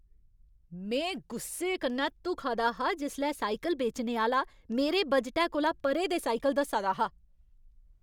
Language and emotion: Dogri, angry